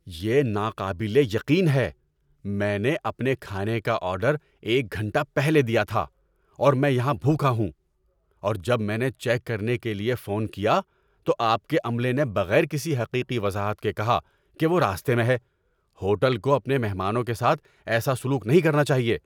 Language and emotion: Urdu, angry